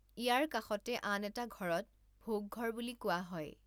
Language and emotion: Assamese, neutral